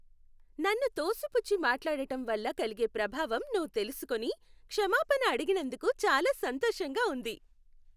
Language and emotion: Telugu, happy